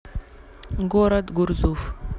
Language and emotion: Russian, neutral